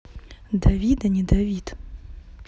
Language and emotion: Russian, neutral